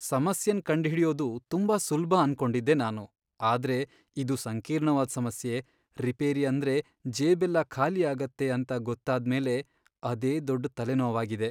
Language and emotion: Kannada, sad